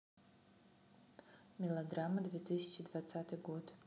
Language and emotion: Russian, neutral